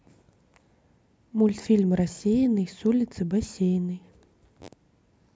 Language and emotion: Russian, neutral